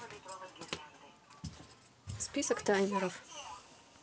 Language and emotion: Russian, neutral